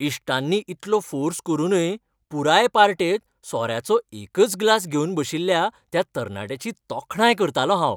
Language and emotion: Goan Konkani, happy